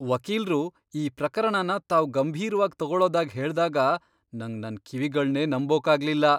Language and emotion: Kannada, surprised